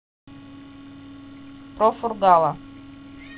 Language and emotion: Russian, neutral